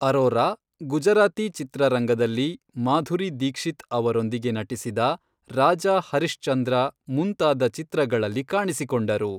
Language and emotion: Kannada, neutral